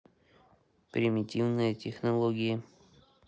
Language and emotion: Russian, neutral